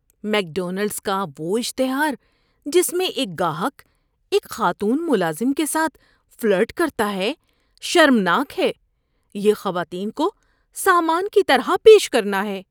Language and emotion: Urdu, disgusted